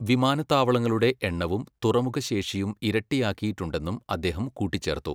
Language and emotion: Malayalam, neutral